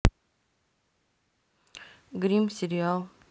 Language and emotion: Russian, neutral